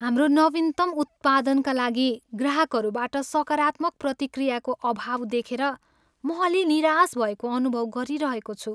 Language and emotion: Nepali, sad